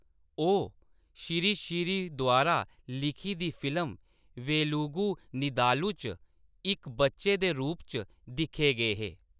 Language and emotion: Dogri, neutral